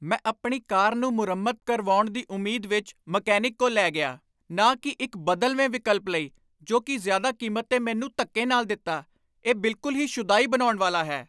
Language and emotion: Punjabi, angry